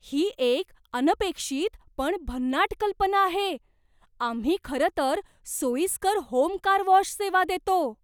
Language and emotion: Marathi, surprised